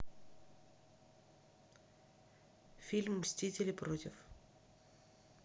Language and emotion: Russian, neutral